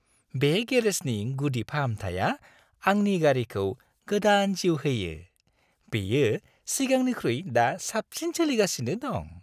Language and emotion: Bodo, happy